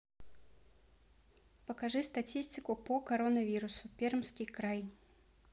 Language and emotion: Russian, neutral